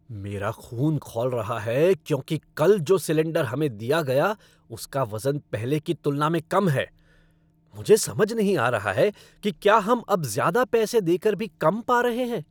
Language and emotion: Hindi, angry